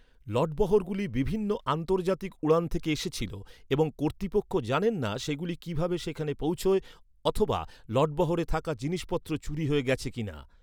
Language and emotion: Bengali, neutral